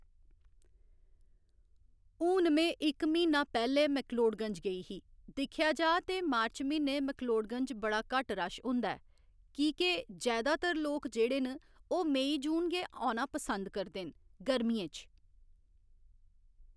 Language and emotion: Dogri, neutral